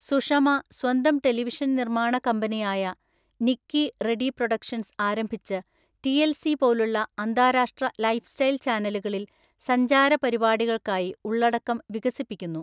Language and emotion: Malayalam, neutral